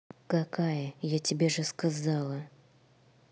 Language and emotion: Russian, angry